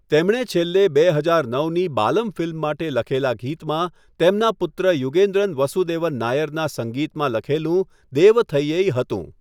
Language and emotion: Gujarati, neutral